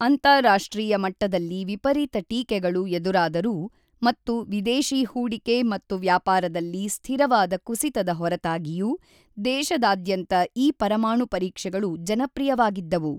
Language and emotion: Kannada, neutral